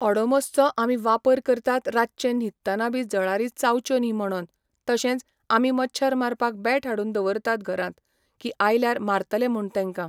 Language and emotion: Goan Konkani, neutral